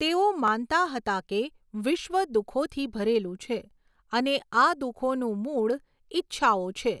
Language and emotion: Gujarati, neutral